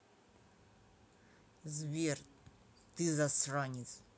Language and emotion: Russian, angry